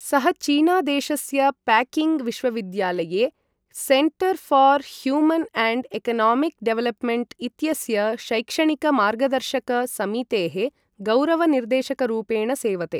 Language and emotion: Sanskrit, neutral